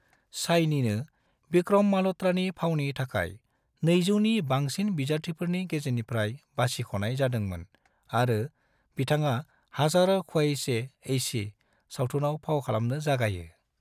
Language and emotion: Bodo, neutral